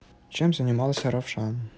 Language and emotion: Russian, neutral